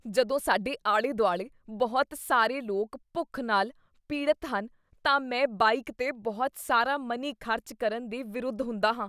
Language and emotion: Punjabi, disgusted